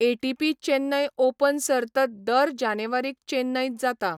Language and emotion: Goan Konkani, neutral